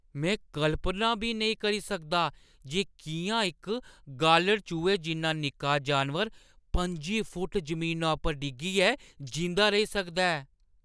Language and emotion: Dogri, surprised